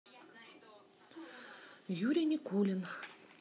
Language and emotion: Russian, neutral